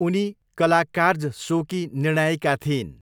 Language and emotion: Nepali, neutral